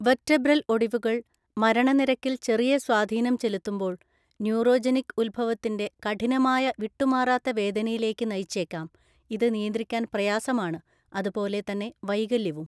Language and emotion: Malayalam, neutral